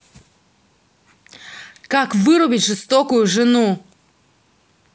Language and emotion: Russian, angry